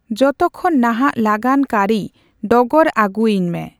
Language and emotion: Santali, neutral